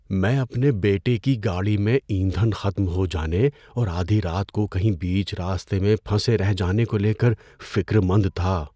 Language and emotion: Urdu, fearful